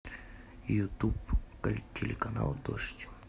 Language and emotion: Russian, neutral